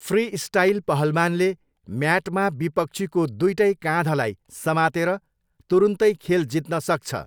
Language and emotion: Nepali, neutral